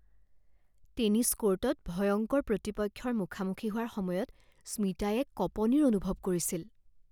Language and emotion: Assamese, fearful